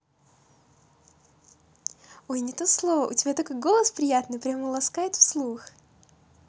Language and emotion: Russian, positive